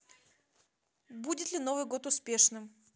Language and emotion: Russian, neutral